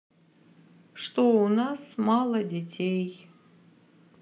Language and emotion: Russian, sad